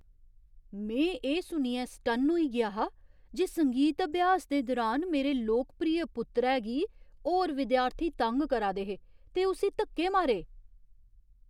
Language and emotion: Dogri, surprised